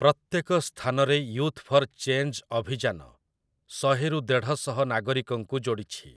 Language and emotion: Odia, neutral